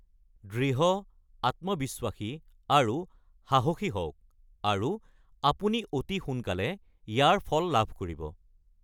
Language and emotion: Assamese, neutral